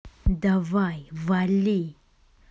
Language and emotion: Russian, angry